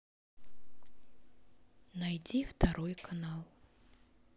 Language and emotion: Russian, neutral